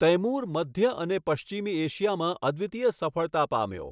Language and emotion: Gujarati, neutral